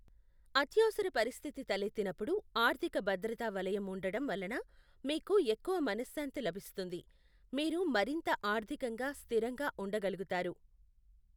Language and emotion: Telugu, neutral